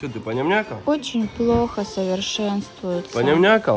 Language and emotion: Russian, sad